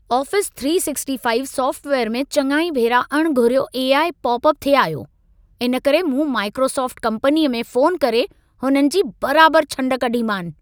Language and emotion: Sindhi, angry